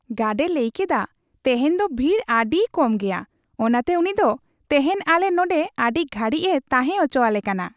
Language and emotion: Santali, happy